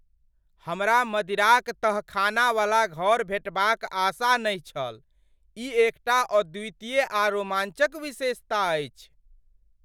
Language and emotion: Maithili, surprised